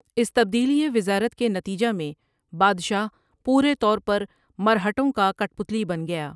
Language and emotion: Urdu, neutral